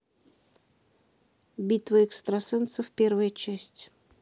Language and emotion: Russian, neutral